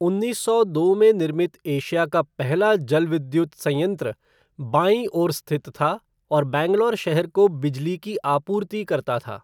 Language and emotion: Hindi, neutral